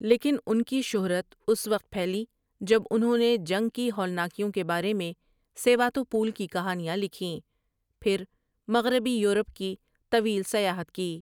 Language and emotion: Urdu, neutral